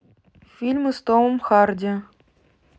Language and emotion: Russian, neutral